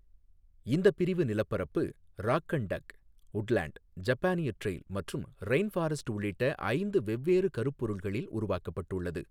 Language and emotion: Tamil, neutral